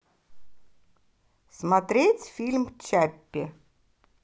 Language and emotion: Russian, positive